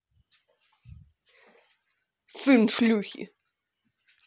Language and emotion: Russian, angry